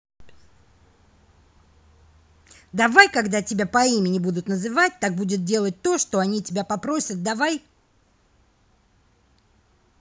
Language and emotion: Russian, angry